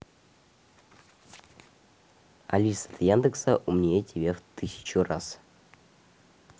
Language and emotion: Russian, neutral